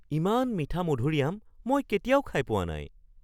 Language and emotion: Assamese, surprised